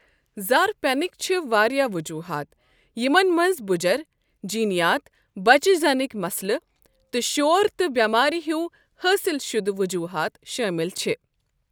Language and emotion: Kashmiri, neutral